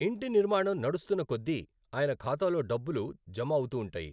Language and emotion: Telugu, neutral